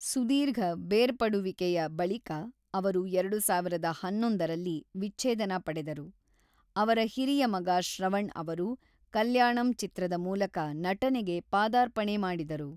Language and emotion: Kannada, neutral